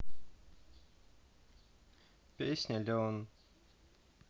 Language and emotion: Russian, neutral